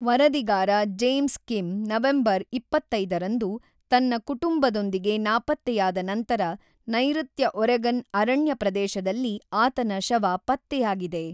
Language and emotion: Kannada, neutral